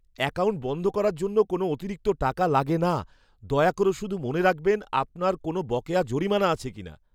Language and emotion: Bengali, fearful